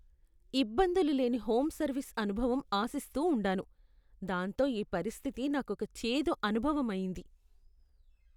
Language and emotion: Telugu, disgusted